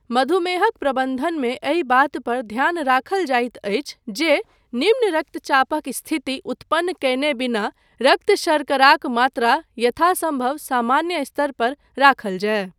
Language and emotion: Maithili, neutral